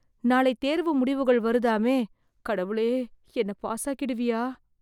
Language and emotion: Tamil, fearful